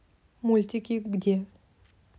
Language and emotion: Russian, neutral